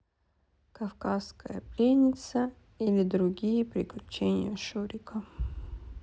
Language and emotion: Russian, sad